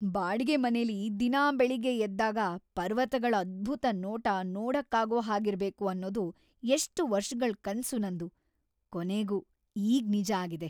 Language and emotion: Kannada, happy